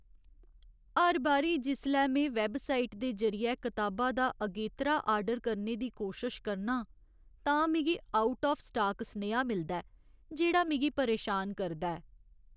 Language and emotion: Dogri, sad